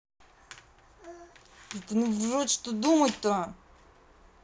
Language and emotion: Russian, angry